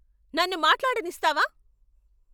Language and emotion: Telugu, angry